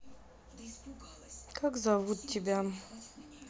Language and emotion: Russian, sad